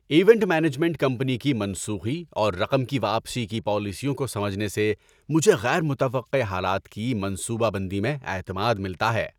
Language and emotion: Urdu, happy